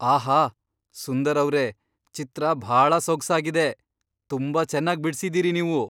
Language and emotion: Kannada, surprised